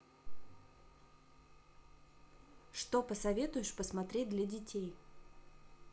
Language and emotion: Russian, neutral